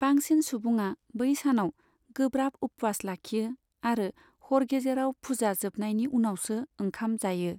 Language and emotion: Bodo, neutral